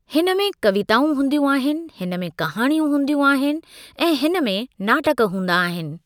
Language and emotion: Sindhi, neutral